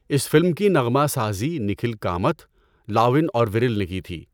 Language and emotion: Urdu, neutral